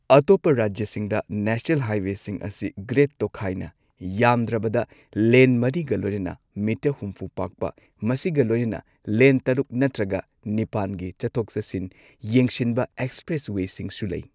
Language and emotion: Manipuri, neutral